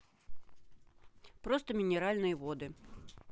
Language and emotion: Russian, neutral